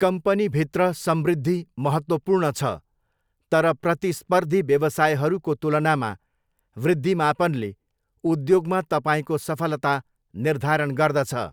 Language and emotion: Nepali, neutral